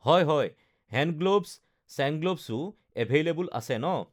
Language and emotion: Assamese, neutral